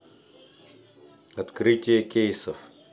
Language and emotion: Russian, neutral